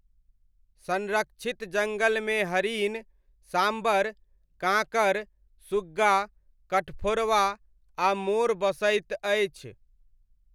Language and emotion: Maithili, neutral